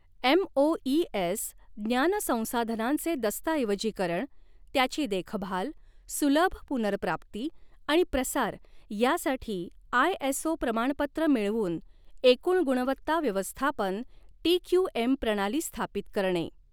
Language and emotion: Marathi, neutral